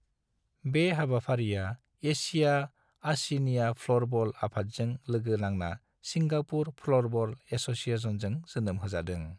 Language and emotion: Bodo, neutral